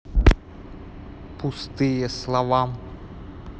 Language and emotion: Russian, neutral